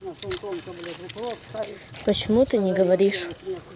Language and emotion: Russian, neutral